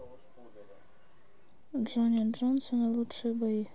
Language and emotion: Russian, neutral